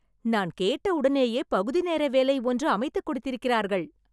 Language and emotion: Tamil, happy